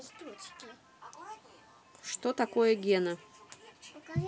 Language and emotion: Russian, neutral